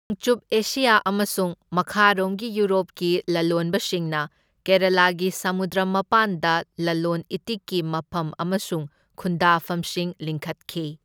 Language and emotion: Manipuri, neutral